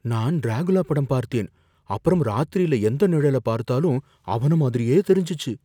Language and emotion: Tamil, fearful